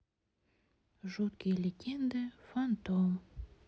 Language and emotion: Russian, sad